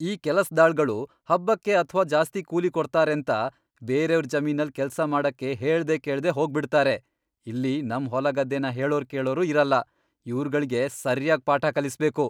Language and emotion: Kannada, angry